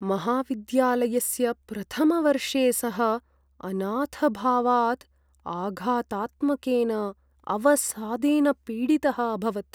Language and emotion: Sanskrit, sad